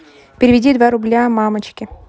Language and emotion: Russian, neutral